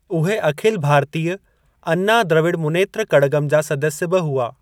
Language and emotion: Sindhi, neutral